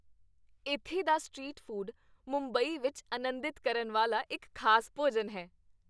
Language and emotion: Punjabi, happy